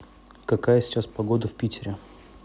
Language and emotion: Russian, neutral